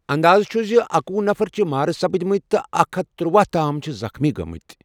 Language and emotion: Kashmiri, neutral